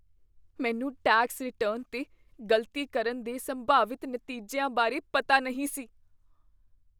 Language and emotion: Punjabi, fearful